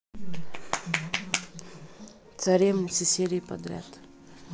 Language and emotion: Russian, neutral